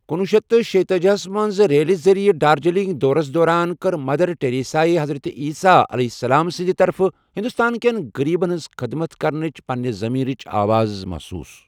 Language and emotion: Kashmiri, neutral